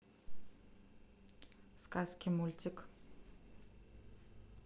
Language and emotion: Russian, neutral